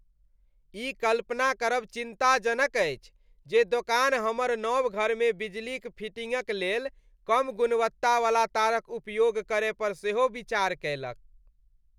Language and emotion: Maithili, disgusted